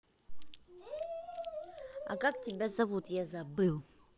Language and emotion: Russian, neutral